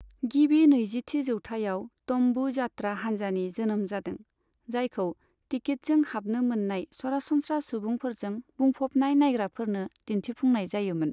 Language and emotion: Bodo, neutral